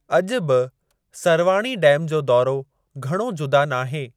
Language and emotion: Sindhi, neutral